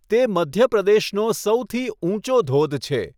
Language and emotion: Gujarati, neutral